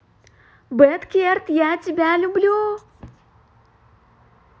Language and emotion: Russian, positive